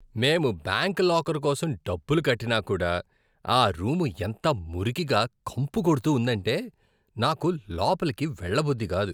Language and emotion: Telugu, disgusted